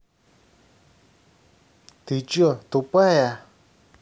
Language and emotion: Russian, angry